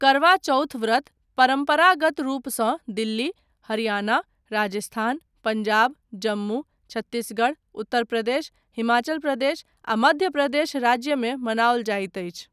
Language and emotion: Maithili, neutral